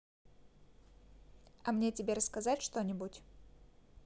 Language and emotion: Russian, neutral